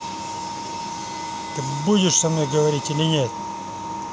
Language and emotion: Russian, angry